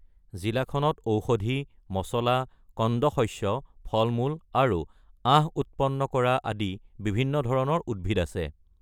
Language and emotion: Assamese, neutral